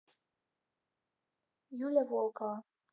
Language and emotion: Russian, neutral